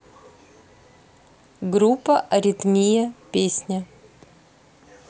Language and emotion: Russian, neutral